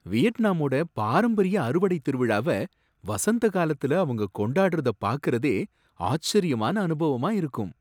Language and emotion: Tamil, surprised